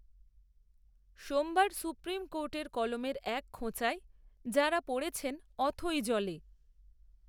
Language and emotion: Bengali, neutral